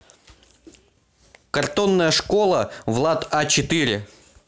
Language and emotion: Russian, neutral